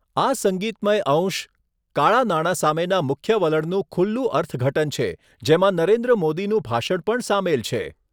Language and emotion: Gujarati, neutral